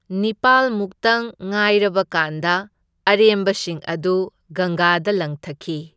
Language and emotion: Manipuri, neutral